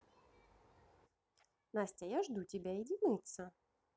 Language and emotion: Russian, positive